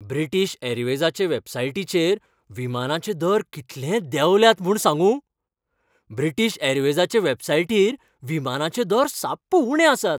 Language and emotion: Goan Konkani, happy